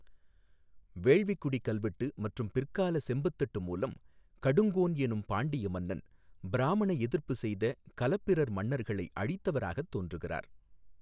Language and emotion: Tamil, neutral